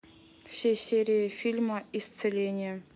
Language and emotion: Russian, neutral